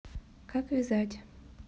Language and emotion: Russian, neutral